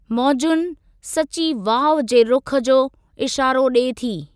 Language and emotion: Sindhi, neutral